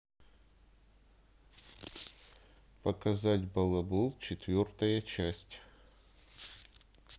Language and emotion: Russian, neutral